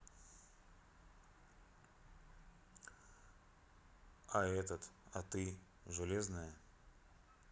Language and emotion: Russian, neutral